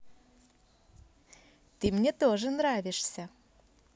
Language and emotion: Russian, positive